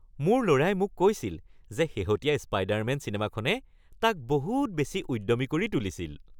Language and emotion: Assamese, happy